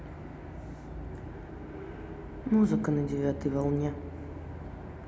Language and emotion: Russian, neutral